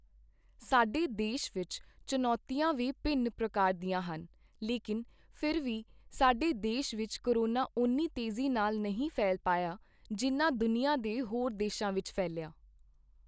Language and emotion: Punjabi, neutral